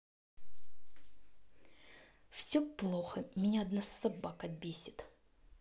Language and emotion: Russian, angry